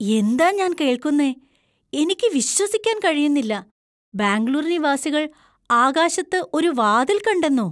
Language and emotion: Malayalam, surprised